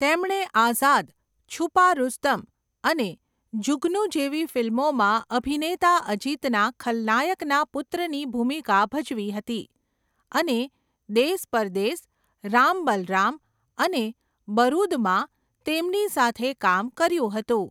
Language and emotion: Gujarati, neutral